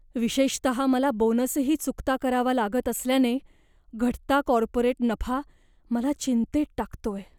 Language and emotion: Marathi, fearful